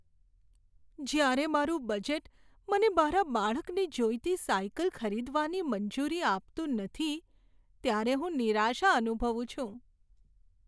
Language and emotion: Gujarati, sad